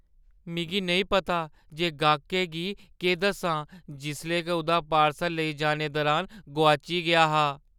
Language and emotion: Dogri, fearful